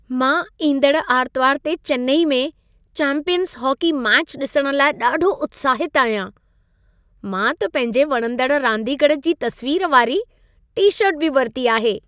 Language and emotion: Sindhi, happy